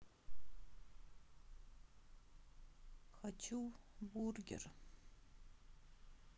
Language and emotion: Russian, sad